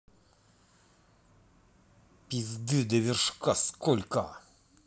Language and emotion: Russian, angry